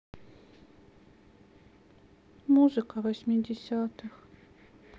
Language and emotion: Russian, sad